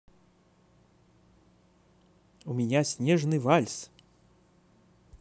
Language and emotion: Russian, positive